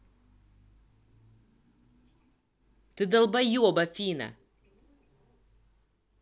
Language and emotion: Russian, angry